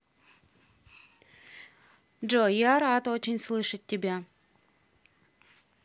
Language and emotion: Russian, neutral